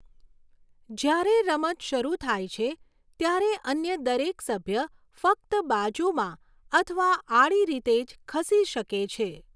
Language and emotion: Gujarati, neutral